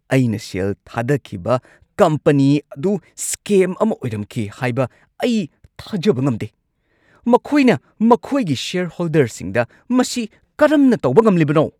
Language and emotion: Manipuri, angry